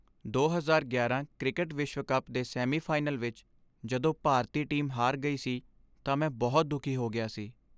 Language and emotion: Punjabi, sad